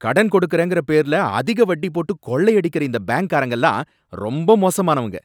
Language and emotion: Tamil, angry